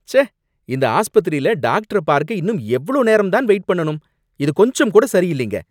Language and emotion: Tamil, angry